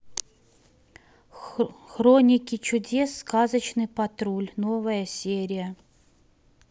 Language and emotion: Russian, neutral